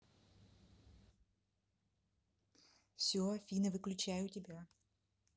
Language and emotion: Russian, neutral